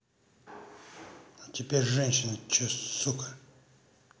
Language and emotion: Russian, angry